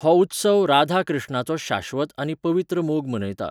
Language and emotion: Goan Konkani, neutral